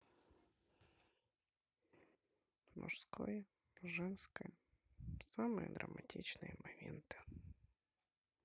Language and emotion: Russian, sad